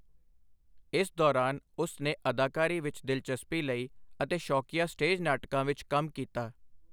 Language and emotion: Punjabi, neutral